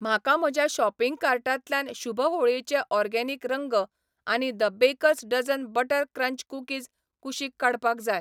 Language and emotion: Goan Konkani, neutral